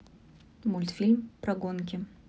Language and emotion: Russian, neutral